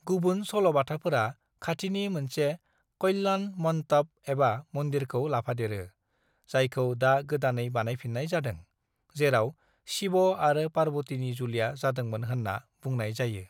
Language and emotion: Bodo, neutral